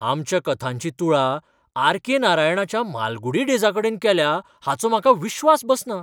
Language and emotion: Goan Konkani, surprised